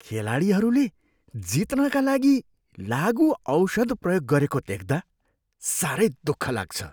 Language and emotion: Nepali, disgusted